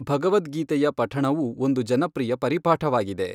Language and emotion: Kannada, neutral